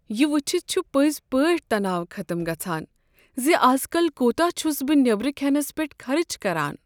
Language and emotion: Kashmiri, sad